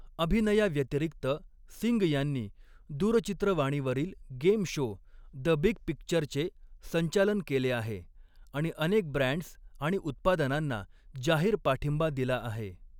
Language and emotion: Marathi, neutral